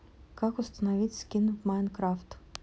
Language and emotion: Russian, neutral